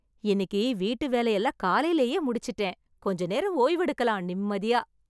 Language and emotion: Tamil, happy